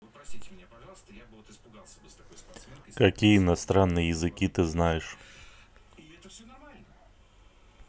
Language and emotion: Russian, neutral